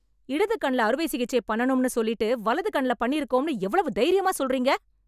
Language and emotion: Tamil, angry